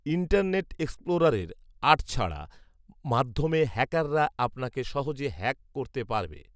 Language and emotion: Bengali, neutral